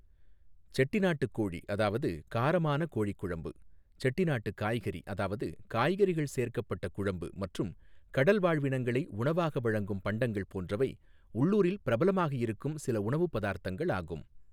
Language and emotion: Tamil, neutral